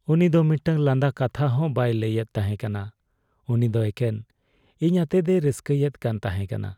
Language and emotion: Santali, sad